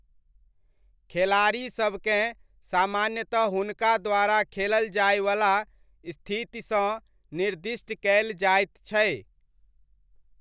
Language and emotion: Maithili, neutral